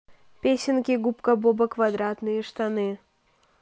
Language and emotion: Russian, neutral